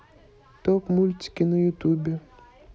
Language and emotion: Russian, neutral